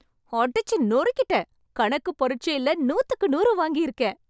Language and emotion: Tamil, happy